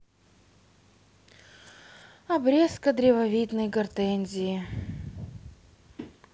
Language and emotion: Russian, sad